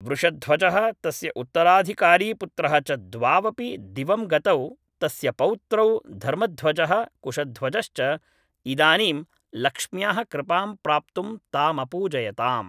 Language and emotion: Sanskrit, neutral